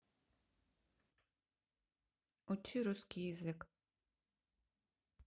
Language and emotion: Russian, neutral